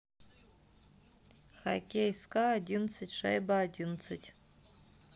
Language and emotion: Russian, neutral